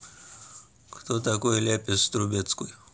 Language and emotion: Russian, neutral